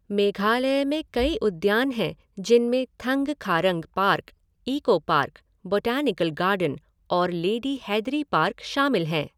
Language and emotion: Hindi, neutral